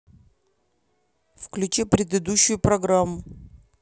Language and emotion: Russian, neutral